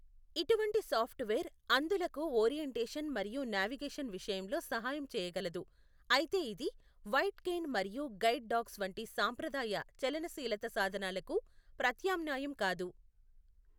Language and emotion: Telugu, neutral